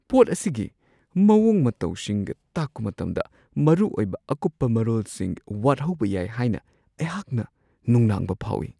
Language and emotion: Manipuri, fearful